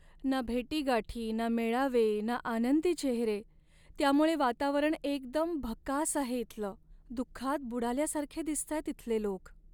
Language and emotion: Marathi, sad